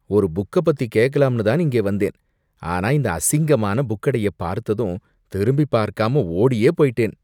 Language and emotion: Tamil, disgusted